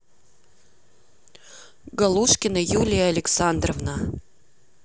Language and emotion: Russian, neutral